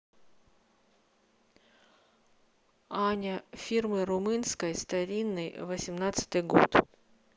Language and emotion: Russian, neutral